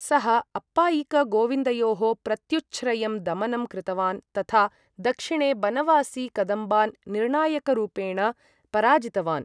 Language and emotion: Sanskrit, neutral